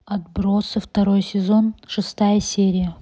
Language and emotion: Russian, neutral